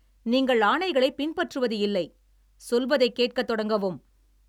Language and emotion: Tamil, angry